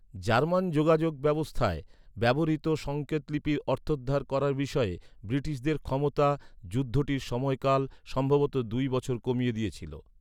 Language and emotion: Bengali, neutral